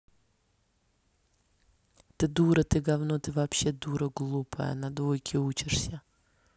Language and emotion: Russian, angry